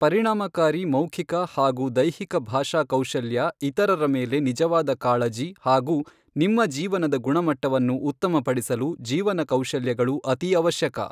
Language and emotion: Kannada, neutral